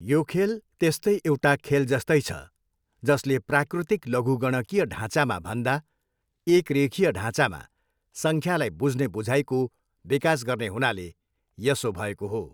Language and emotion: Nepali, neutral